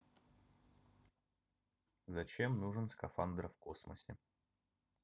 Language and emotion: Russian, neutral